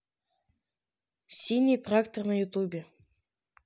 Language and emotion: Russian, neutral